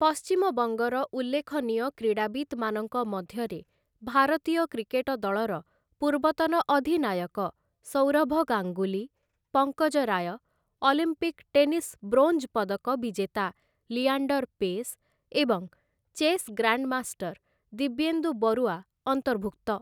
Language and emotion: Odia, neutral